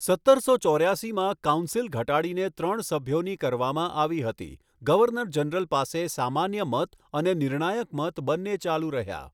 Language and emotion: Gujarati, neutral